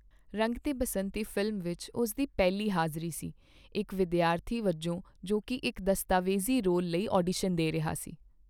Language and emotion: Punjabi, neutral